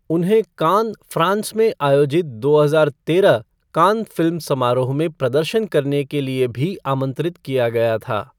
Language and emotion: Hindi, neutral